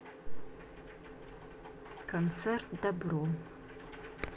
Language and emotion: Russian, neutral